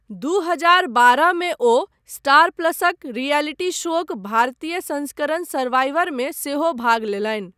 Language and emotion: Maithili, neutral